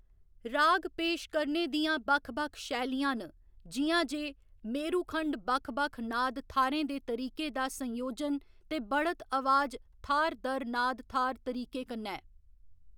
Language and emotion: Dogri, neutral